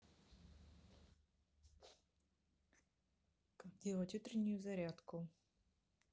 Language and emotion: Russian, neutral